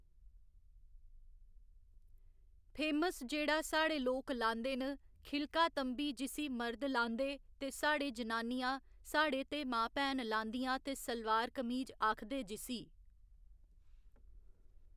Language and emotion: Dogri, neutral